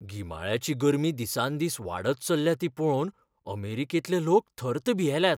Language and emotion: Goan Konkani, fearful